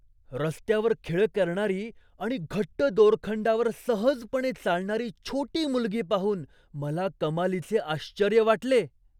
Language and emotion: Marathi, surprised